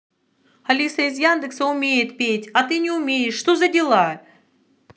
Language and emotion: Russian, angry